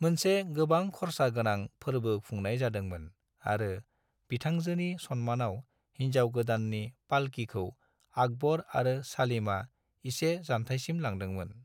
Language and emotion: Bodo, neutral